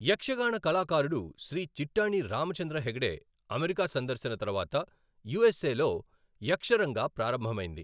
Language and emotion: Telugu, neutral